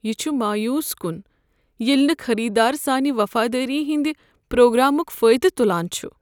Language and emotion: Kashmiri, sad